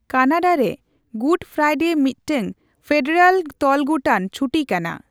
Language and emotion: Santali, neutral